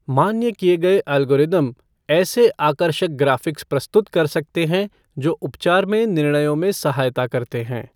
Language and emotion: Hindi, neutral